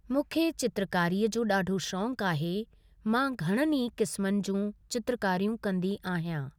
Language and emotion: Sindhi, neutral